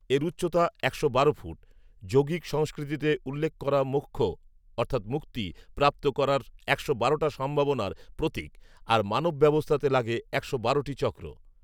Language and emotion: Bengali, neutral